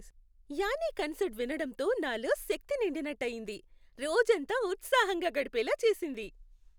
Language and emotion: Telugu, happy